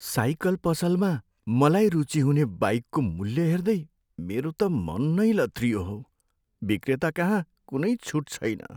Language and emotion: Nepali, sad